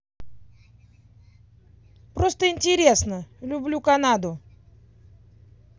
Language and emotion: Russian, positive